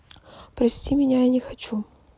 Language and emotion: Russian, neutral